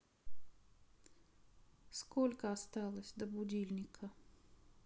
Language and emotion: Russian, sad